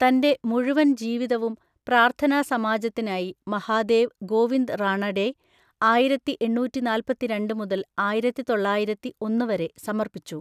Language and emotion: Malayalam, neutral